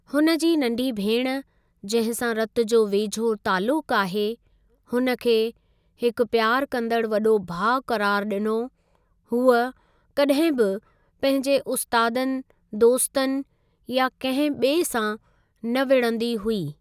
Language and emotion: Sindhi, neutral